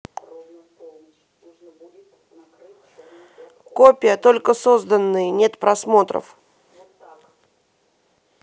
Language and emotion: Russian, neutral